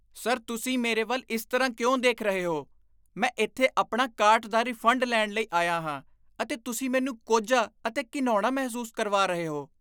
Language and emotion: Punjabi, disgusted